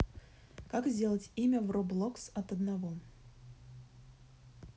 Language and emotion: Russian, neutral